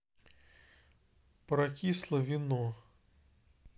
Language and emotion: Russian, neutral